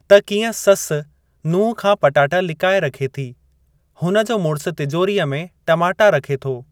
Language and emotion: Sindhi, neutral